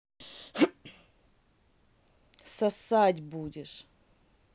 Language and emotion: Russian, angry